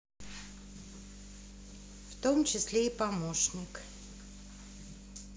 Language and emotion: Russian, neutral